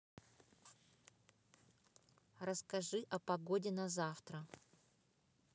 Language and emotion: Russian, neutral